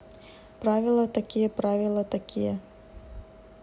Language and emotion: Russian, neutral